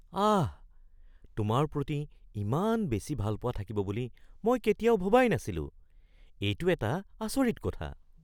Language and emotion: Assamese, surprised